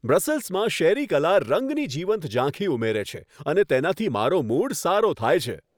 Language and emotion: Gujarati, happy